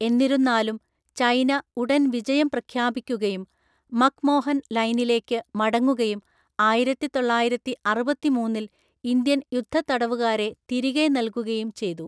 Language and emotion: Malayalam, neutral